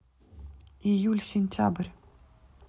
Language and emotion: Russian, neutral